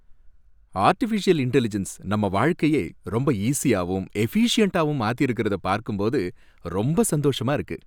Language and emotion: Tamil, happy